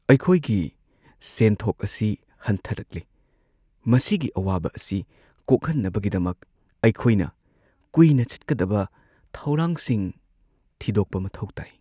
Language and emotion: Manipuri, sad